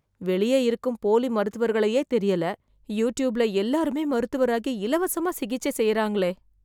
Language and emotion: Tamil, fearful